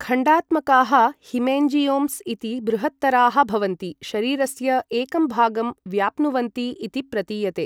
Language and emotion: Sanskrit, neutral